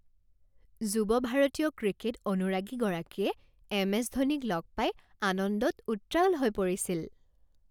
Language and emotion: Assamese, happy